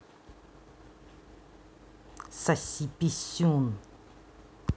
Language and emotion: Russian, angry